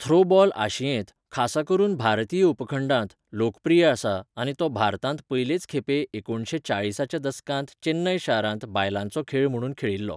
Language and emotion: Goan Konkani, neutral